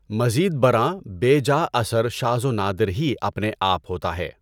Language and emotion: Urdu, neutral